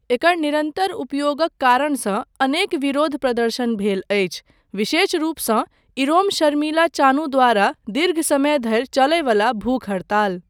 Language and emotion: Maithili, neutral